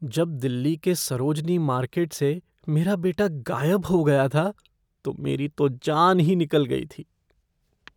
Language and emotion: Hindi, fearful